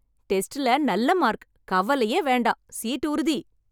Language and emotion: Tamil, happy